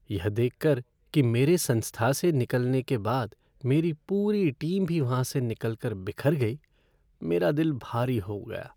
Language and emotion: Hindi, sad